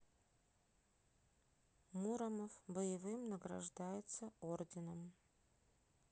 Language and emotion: Russian, neutral